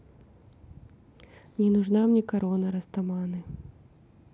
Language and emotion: Russian, sad